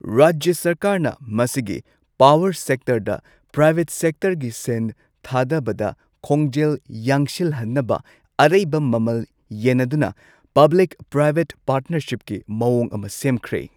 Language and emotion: Manipuri, neutral